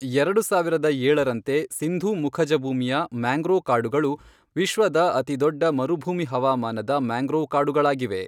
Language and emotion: Kannada, neutral